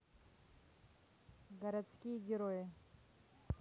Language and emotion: Russian, neutral